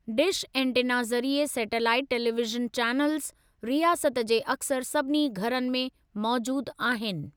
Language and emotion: Sindhi, neutral